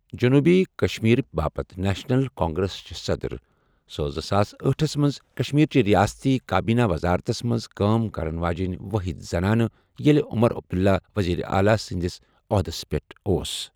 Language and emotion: Kashmiri, neutral